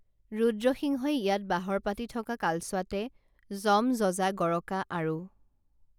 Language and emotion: Assamese, neutral